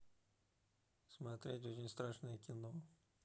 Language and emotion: Russian, neutral